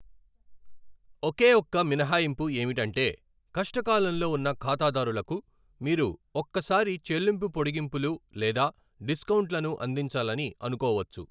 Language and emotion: Telugu, neutral